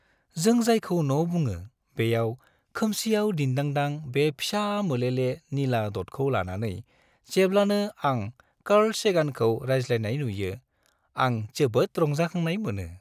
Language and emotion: Bodo, happy